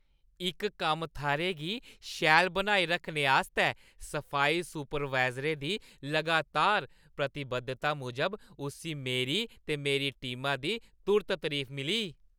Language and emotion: Dogri, happy